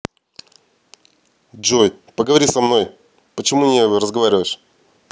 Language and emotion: Russian, angry